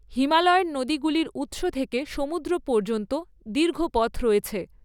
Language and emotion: Bengali, neutral